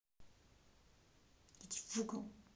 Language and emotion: Russian, angry